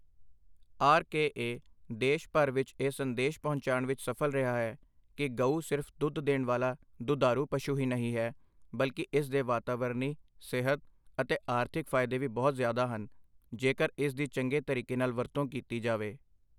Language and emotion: Punjabi, neutral